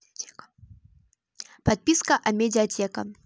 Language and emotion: Russian, neutral